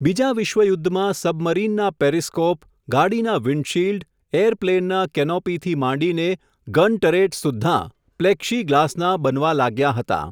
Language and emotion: Gujarati, neutral